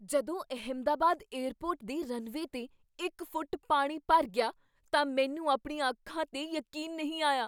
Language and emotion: Punjabi, surprised